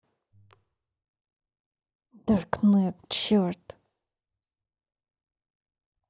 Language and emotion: Russian, angry